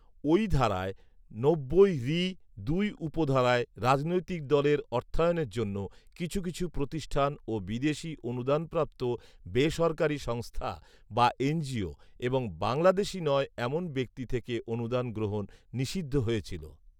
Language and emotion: Bengali, neutral